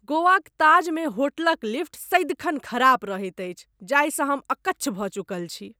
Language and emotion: Maithili, disgusted